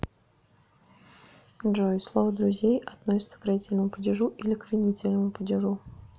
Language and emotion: Russian, neutral